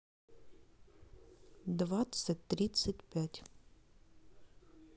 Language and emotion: Russian, neutral